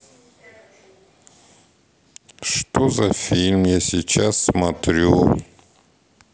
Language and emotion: Russian, sad